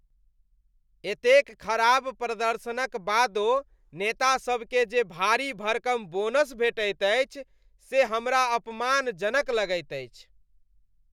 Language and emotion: Maithili, disgusted